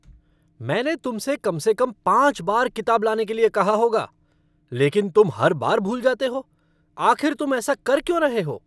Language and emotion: Hindi, angry